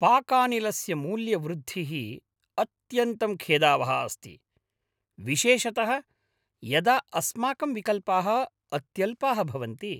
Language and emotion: Sanskrit, angry